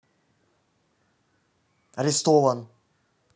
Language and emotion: Russian, neutral